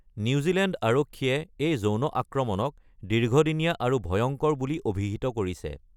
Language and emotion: Assamese, neutral